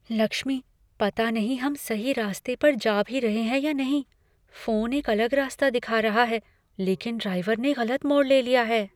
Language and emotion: Hindi, fearful